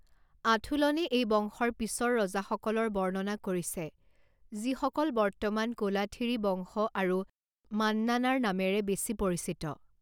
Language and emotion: Assamese, neutral